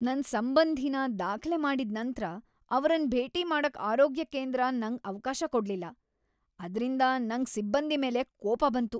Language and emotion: Kannada, angry